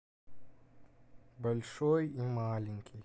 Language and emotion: Russian, sad